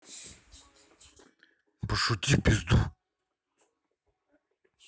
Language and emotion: Russian, angry